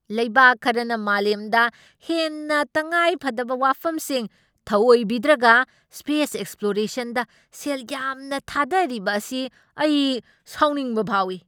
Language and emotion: Manipuri, angry